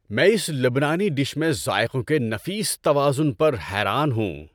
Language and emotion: Urdu, happy